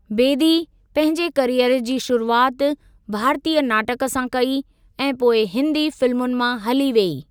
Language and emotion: Sindhi, neutral